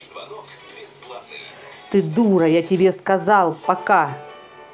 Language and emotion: Russian, angry